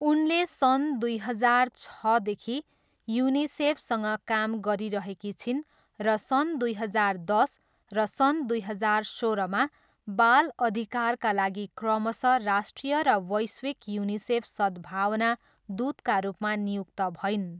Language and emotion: Nepali, neutral